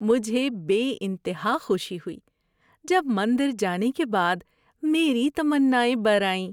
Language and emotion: Urdu, happy